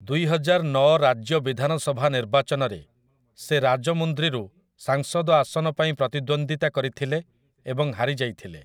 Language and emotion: Odia, neutral